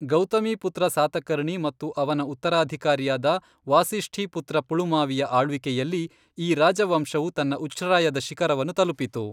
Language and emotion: Kannada, neutral